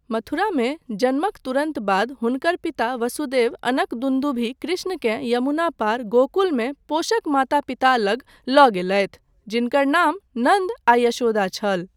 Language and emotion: Maithili, neutral